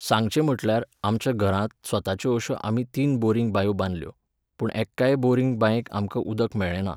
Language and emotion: Goan Konkani, neutral